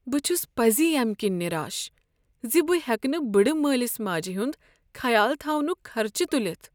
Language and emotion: Kashmiri, sad